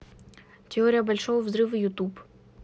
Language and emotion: Russian, neutral